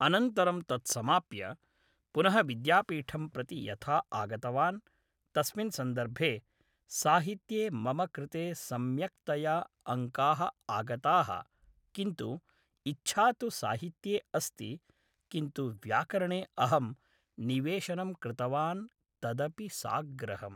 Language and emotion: Sanskrit, neutral